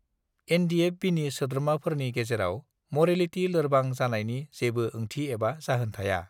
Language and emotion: Bodo, neutral